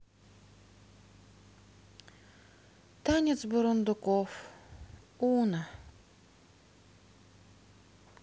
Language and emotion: Russian, sad